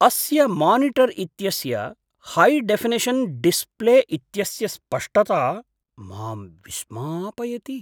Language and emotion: Sanskrit, surprised